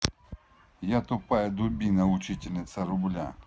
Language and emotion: Russian, angry